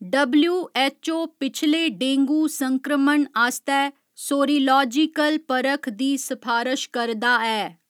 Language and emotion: Dogri, neutral